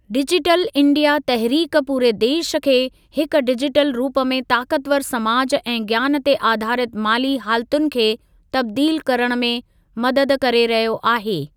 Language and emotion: Sindhi, neutral